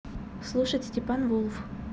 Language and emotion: Russian, neutral